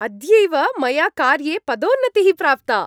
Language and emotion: Sanskrit, happy